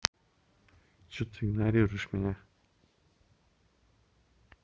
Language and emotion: Russian, neutral